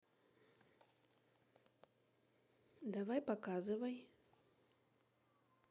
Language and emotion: Russian, neutral